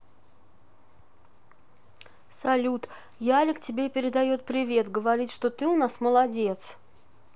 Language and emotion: Russian, neutral